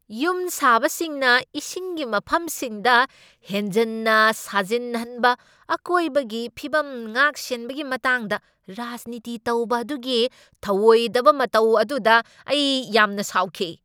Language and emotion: Manipuri, angry